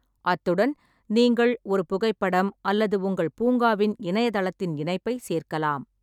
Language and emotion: Tamil, neutral